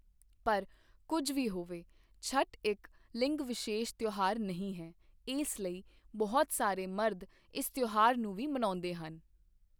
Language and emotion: Punjabi, neutral